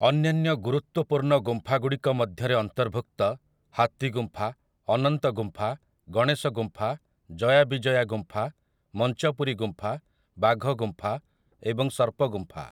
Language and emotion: Odia, neutral